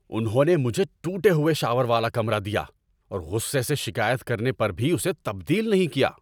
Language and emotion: Urdu, angry